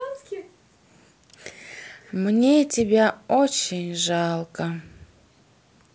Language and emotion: Russian, sad